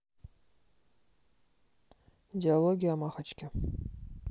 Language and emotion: Russian, neutral